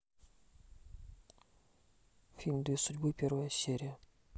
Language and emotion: Russian, neutral